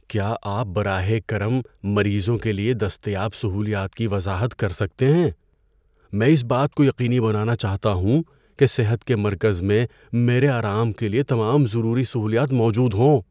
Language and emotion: Urdu, fearful